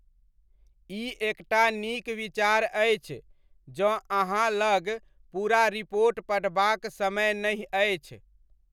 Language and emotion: Maithili, neutral